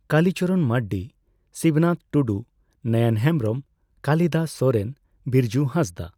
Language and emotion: Santali, neutral